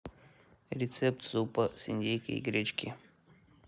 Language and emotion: Russian, neutral